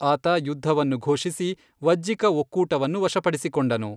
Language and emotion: Kannada, neutral